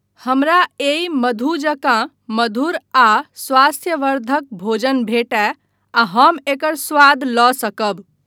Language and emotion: Maithili, neutral